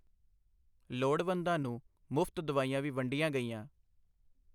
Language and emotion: Punjabi, neutral